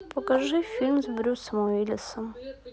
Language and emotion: Russian, sad